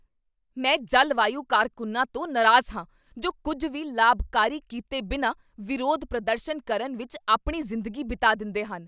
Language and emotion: Punjabi, angry